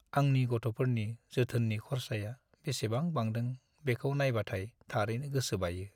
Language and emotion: Bodo, sad